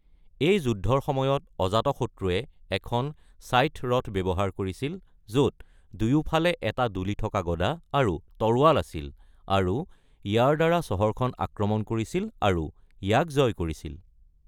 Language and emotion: Assamese, neutral